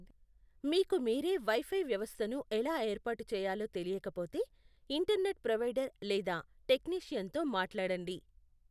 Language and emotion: Telugu, neutral